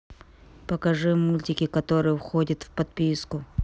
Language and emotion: Russian, angry